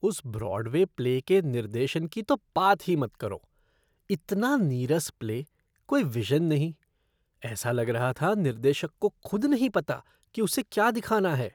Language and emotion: Hindi, disgusted